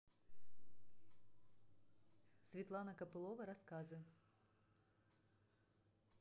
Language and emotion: Russian, neutral